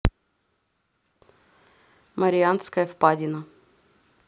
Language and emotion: Russian, neutral